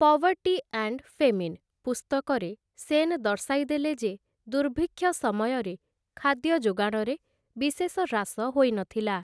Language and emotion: Odia, neutral